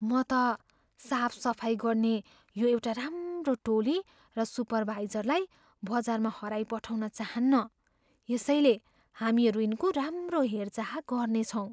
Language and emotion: Nepali, fearful